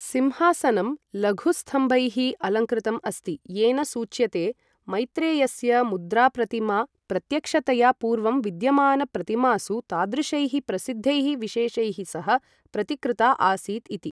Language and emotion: Sanskrit, neutral